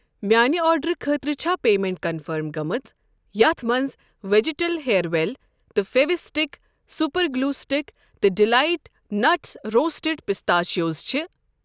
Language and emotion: Kashmiri, neutral